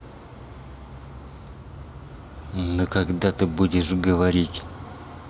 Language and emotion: Russian, angry